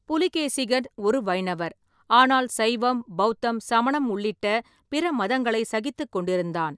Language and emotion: Tamil, neutral